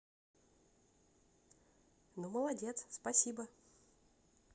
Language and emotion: Russian, positive